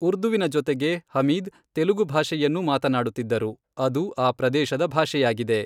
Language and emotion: Kannada, neutral